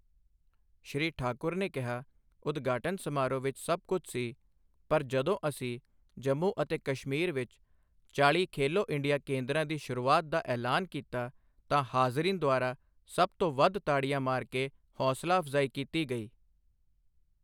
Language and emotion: Punjabi, neutral